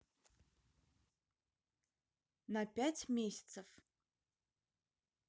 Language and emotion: Russian, neutral